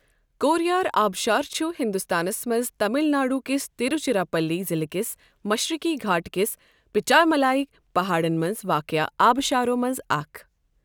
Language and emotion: Kashmiri, neutral